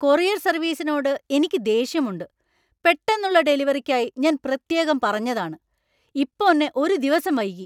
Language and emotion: Malayalam, angry